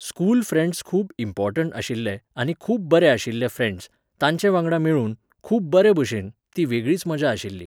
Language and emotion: Goan Konkani, neutral